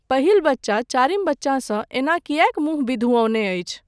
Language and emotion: Maithili, neutral